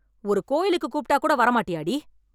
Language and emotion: Tamil, angry